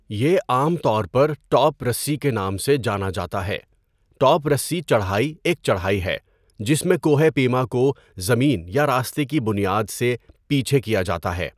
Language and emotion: Urdu, neutral